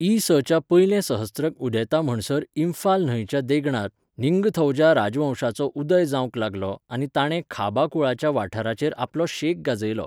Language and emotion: Goan Konkani, neutral